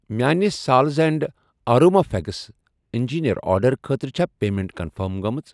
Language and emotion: Kashmiri, neutral